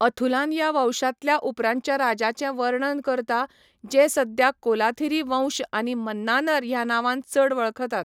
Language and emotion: Goan Konkani, neutral